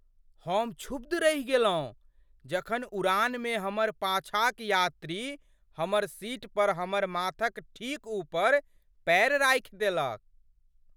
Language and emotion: Maithili, surprised